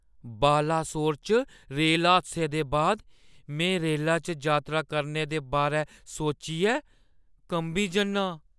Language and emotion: Dogri, fearful